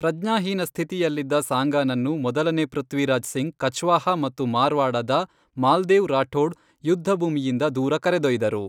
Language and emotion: Kannada, neutral